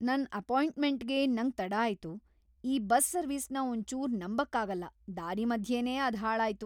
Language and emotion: Kannada, angry